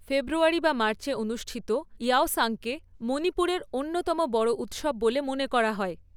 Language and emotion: Bengali, neutral